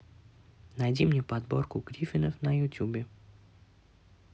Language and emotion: Russian, neutral